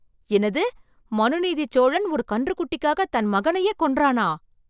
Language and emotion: Tamil, surprised